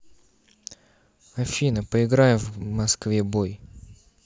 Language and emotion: Russian, neutral